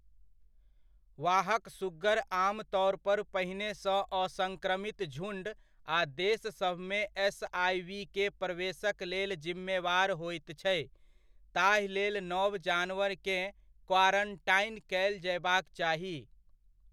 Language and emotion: Maithili, neutral